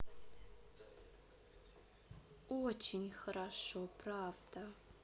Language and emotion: Russian, positive